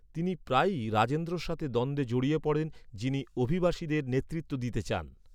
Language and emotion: Bengali, neutral